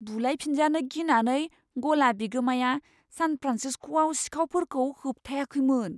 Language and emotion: Bodo, fearful